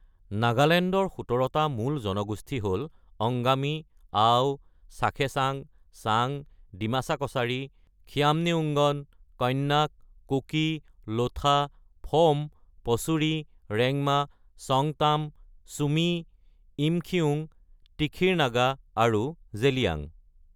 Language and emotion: Assamese, neutral